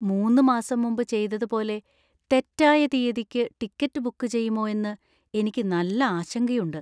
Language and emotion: Malayalam, fearful